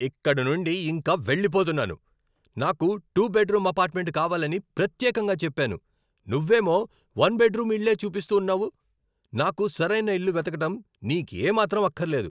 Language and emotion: Telugu, angry